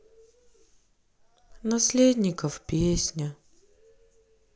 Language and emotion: Russian, sad